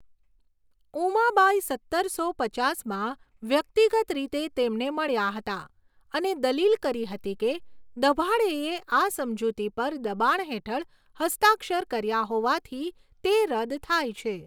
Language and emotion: Gujarati, neutral